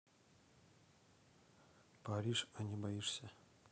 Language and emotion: Russian, neutral